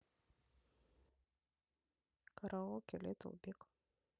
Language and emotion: Russian, neutral